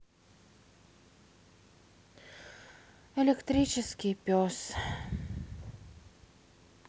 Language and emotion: Russian, sad